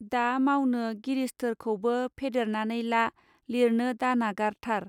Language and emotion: Bodo, neutral